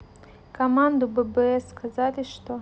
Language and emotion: Russian, neutral